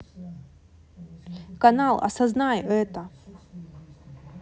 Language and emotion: Russian, neutral